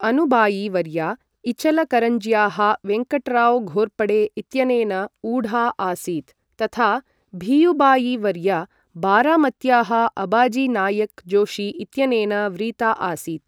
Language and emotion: Sanskrit, neutral